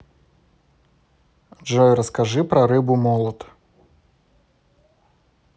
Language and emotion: Russian, neutral